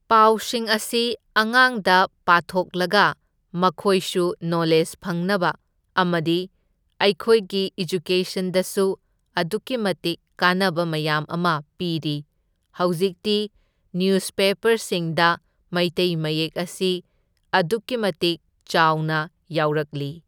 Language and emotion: Manipuri, neutral